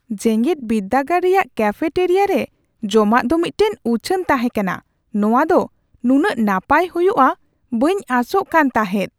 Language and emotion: Santali, surprised